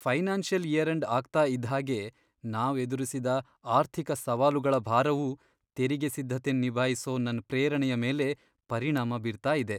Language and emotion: Kannada, sad